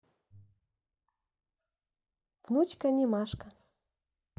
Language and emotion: Russian, neutral